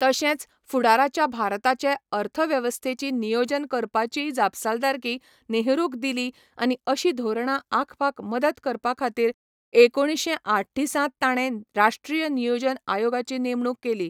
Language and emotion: Goan Konkani, neutral